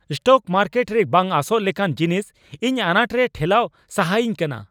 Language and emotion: Santali, angry